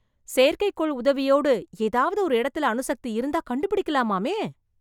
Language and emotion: Tamil, surprised